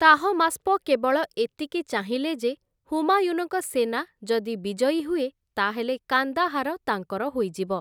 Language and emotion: Odia, neutral